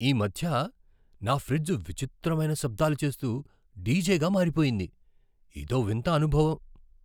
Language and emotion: Telugu, surprised